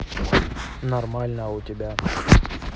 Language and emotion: Russian, neutral